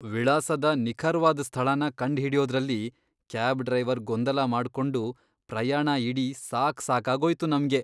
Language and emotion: Kannada, disgusted